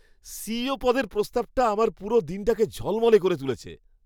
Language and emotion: Bengali, happy